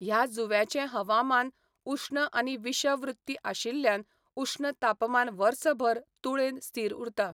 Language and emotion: Goan Konkani, neutral